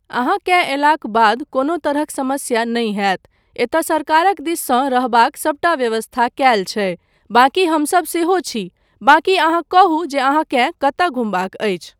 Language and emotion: Maithili, neutral